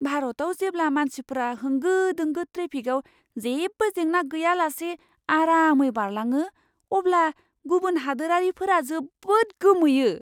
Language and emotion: Bodo, surprised